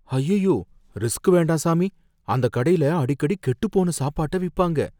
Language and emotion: Tamil, fearful